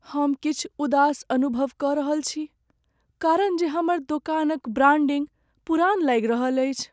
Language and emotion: Maithili, sad